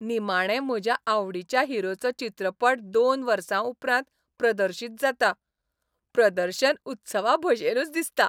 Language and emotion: Goan Konkani, happy